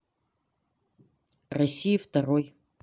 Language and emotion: Russian, neutral